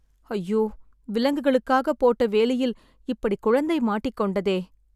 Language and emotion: Tamil, sad